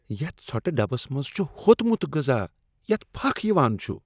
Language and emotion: Kashmiri, disgusted